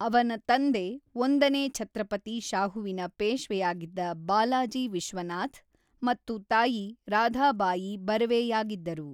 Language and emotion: Kannada, neutral